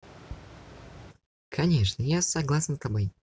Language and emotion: Russian, neutral